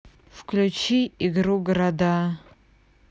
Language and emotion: Russian, neutral